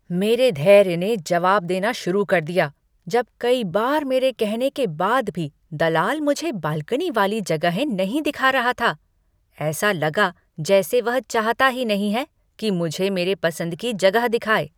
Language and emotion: Hindi, angry